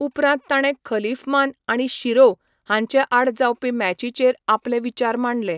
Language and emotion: Goan Konkani, neutral